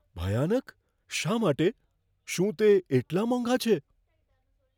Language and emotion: Gujarati, fearful